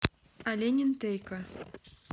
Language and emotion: Russian, neutral